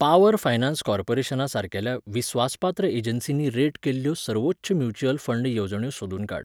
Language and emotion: Goan Konkani, neutral